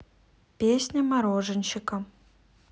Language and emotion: Russian, neutral